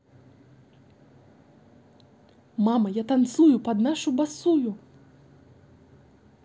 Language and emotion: Russian, positive